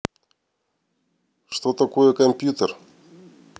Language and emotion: Russian, neutral